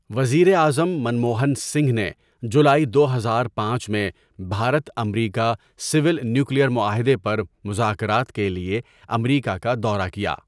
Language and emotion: Urdu, neutral